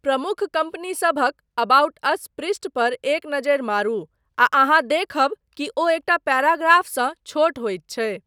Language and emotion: Maithili, neutral